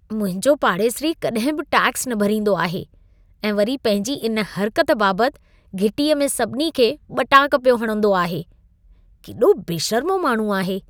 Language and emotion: Sindhi, disgusted